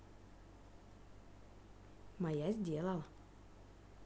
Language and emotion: Russian, neutral